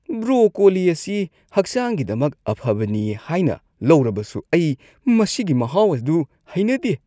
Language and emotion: Manipuri, disgusted